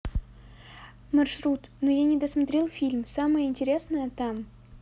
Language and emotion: Russian, neutral